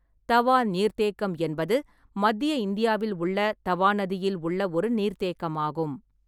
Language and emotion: Tamil, neutral